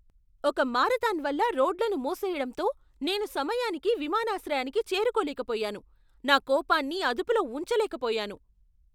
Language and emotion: Telugu, angry